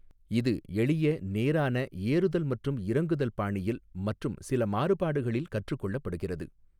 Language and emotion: Tamil, neutral